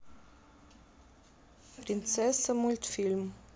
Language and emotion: Russian, neutral